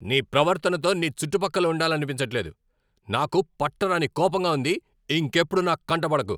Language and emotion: Telugu, angry